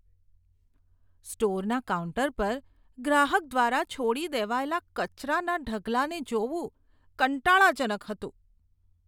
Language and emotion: Gujarati, disgusted